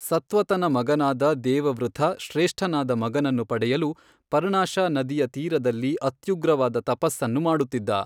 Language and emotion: Kannada, neutral